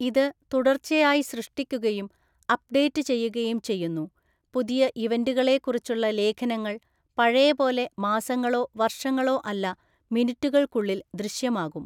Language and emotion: Malayalam, neutral